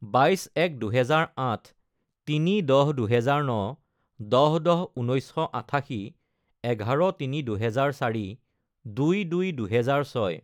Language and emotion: Assamese, neutral